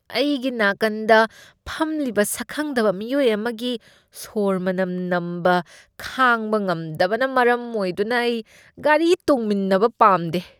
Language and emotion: Manipuri, disgusted